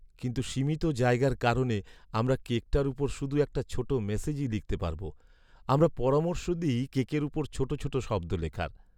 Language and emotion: Bengali, sad